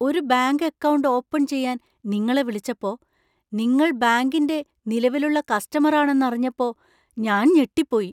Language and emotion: Malayalam, surprised